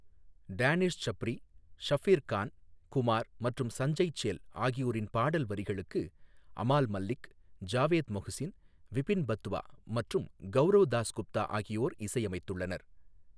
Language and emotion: Tamil, neutral